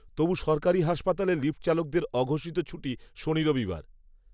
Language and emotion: Bengali, neutral